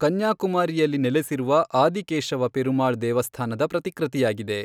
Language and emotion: Kannada, neutral